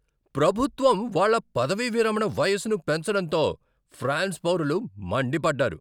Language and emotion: Telugu, angry